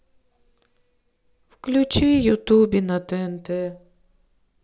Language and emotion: Russian, sad